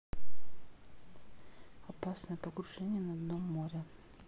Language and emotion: Russian, neutral